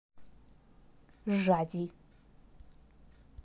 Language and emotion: Russian, neutral